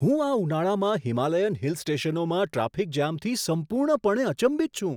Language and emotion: Gujarati, surprised